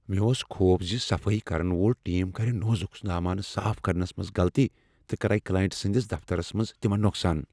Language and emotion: Kashmiri, fearful